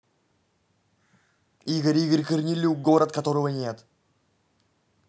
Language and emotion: Russian, angry